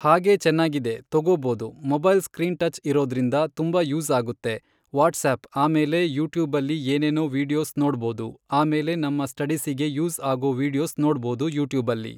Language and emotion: Kannada, neutral